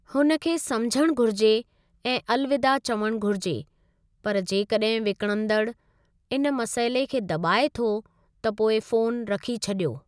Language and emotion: Sindhi, neutral